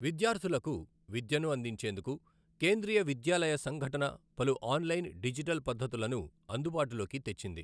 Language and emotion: Telugu, neutral